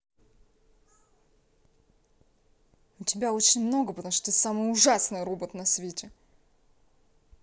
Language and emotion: Russian, angry